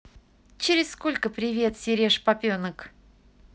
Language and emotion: Russian, positive